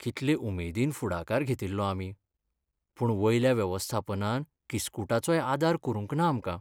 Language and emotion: Goan Konkani, sad